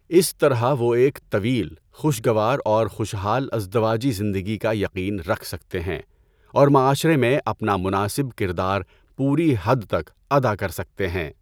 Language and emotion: Urdu, neutral